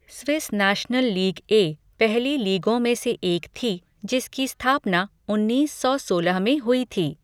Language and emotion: Hindi, neutral